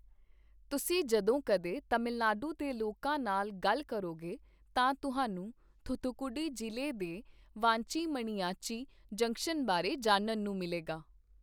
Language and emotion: Punjabi, neutral